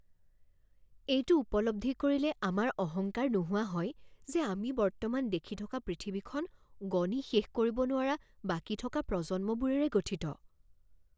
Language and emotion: Assamese, fearful